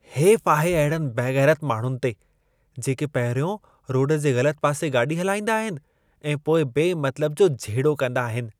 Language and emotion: Sindhi, disgusted